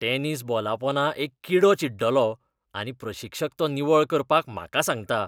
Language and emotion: Goan Konkani, disgusted